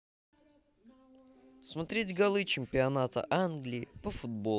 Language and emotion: Russian, positive